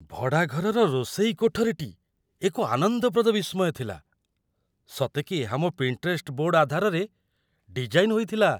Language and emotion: Odia, surprised